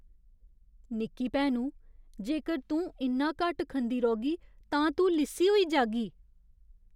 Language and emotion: Dogri, fearful